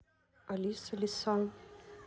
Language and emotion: Russian, neutral